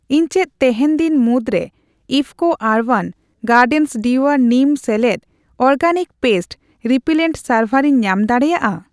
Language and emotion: Santali, neutral